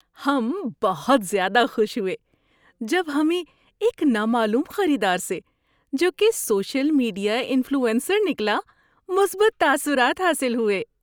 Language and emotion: Urdu, happy